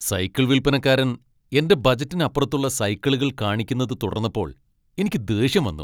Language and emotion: Malayalam, angry